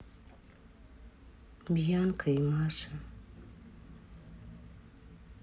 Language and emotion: Russian, sad